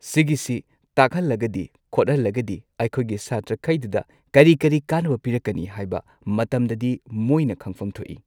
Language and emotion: Manipuri, neutral